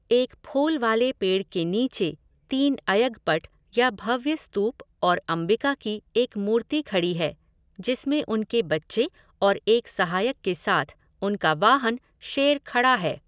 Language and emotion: Hindi, neutral